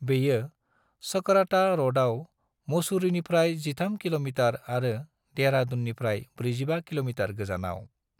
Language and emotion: Bodo, neutral